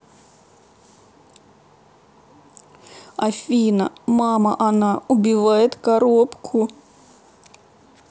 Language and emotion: Russian, sad